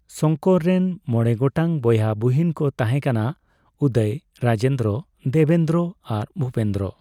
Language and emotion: Santali, neutral